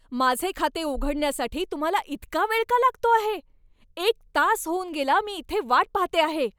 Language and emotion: Marathi, angry